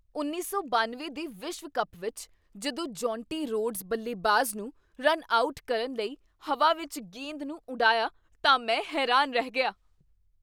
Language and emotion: Punjabi, surprised